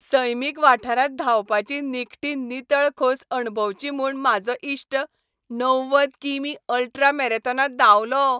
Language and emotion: Goan Konkani, happy